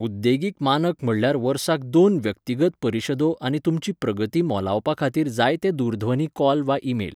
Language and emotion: Goan Konkani, neutral